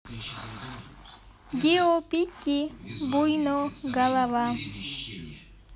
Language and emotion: Russian, neutral